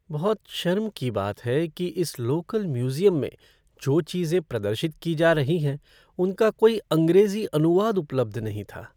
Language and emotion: Hindi, sad